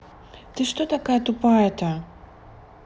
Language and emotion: Russian, neutral